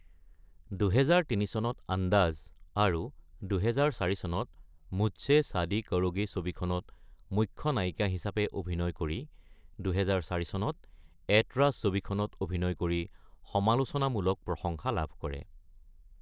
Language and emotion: Assamese, neutral